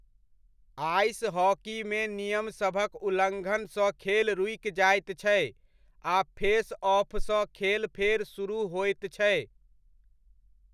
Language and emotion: Maithili, neutral